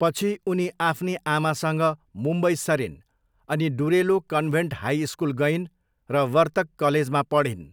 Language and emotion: Nepali, neutral